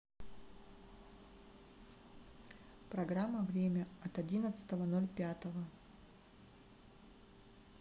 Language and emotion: Russian, sad